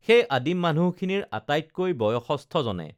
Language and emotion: Assamese, neutral